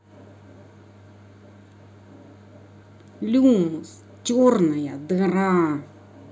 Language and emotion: Russian, angry